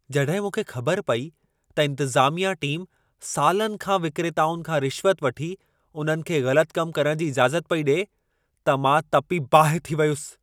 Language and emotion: Sindhi, angry